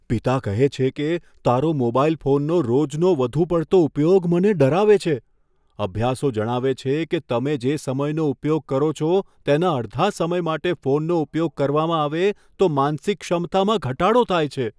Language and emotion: Gujarati, fearful